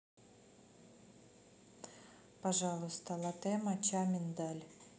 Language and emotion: Russian, neutral